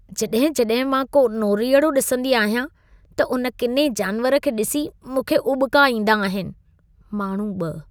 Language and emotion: Sindhi, disgusted